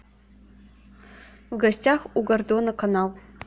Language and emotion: Russian, neutral